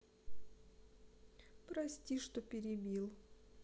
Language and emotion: Russian, sad